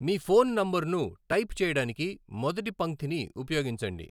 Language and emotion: Telugu, neutral